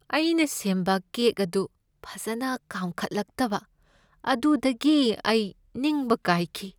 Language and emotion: Manipuri, sad